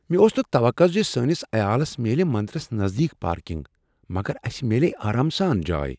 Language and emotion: Kashmiri, surprised